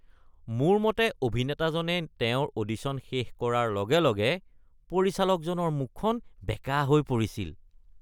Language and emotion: Assamese, disgusted